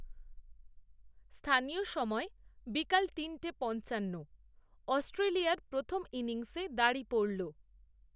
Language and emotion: Bengali, neutral